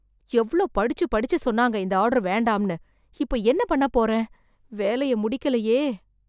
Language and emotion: Tamil, fearful